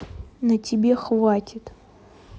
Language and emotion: Russian, neutral